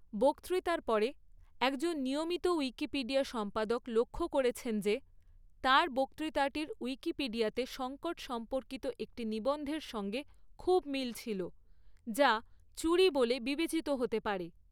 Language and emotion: Bengali, neutral